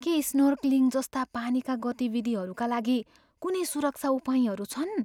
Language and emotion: Nepali, fearful